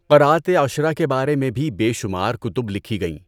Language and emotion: Urdu, neutral